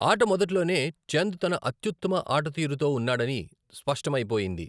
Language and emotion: Telugu, neutral